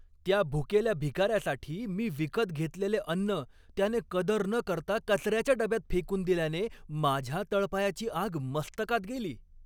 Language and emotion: Marathi, angry